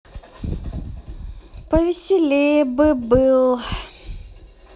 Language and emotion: Russian, sad